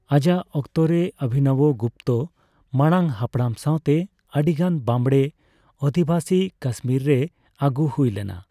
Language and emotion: Santali, neutral